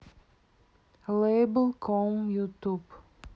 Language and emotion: Russian, neutral